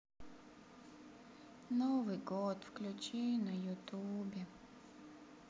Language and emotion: Russian, sad